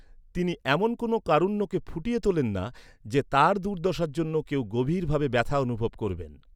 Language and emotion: Bengali, neutral